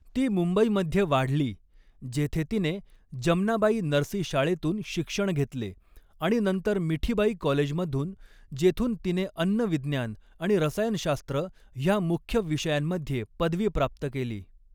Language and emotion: Marathi, neutral